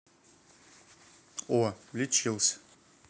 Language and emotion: Russian, neutral